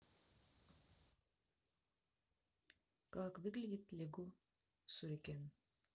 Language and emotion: Russian, neutral